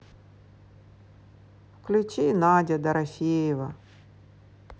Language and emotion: Russian, sad